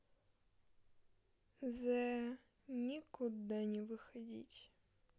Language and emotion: Russian, sad